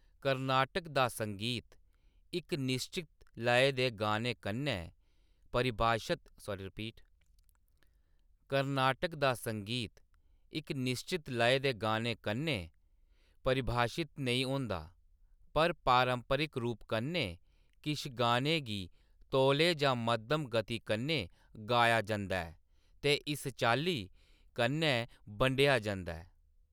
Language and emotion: Dogri, neutral